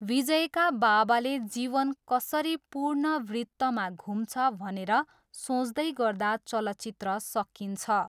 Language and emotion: Nepali, neutral